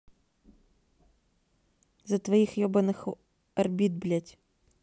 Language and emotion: Russian, neutral